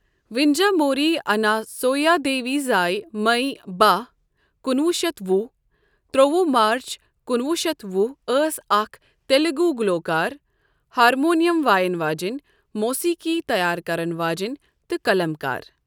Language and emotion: Kashmiri, neutral